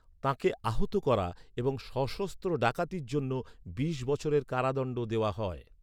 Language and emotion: Bengali, neutral